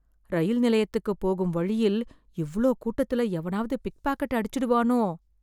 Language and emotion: Tamil, fearful